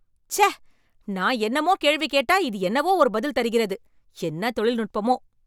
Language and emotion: Tamil, angry